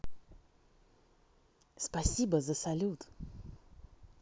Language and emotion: Russian, positive